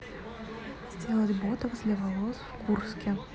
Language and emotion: Russian, neutral